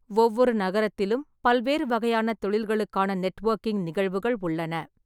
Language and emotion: Tamil, neutral